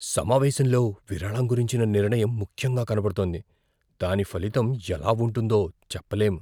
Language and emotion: Telugu, fearful